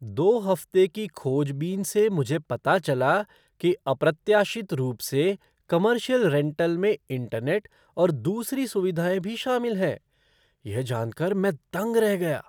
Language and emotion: Hindi, surprised